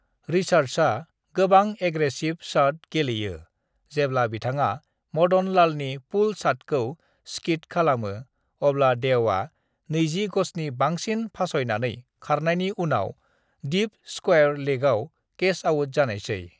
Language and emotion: Bodo, neutral